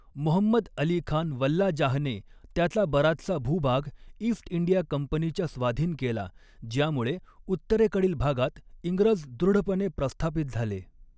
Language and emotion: Marathi, neutral